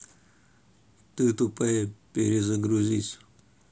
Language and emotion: Russian, neutral